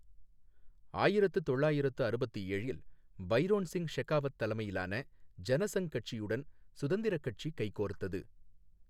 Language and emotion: Tamil, neutral